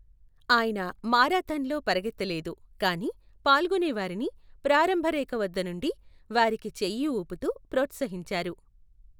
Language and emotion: Telugu, neutral